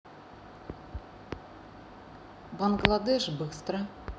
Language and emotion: Russian, neutral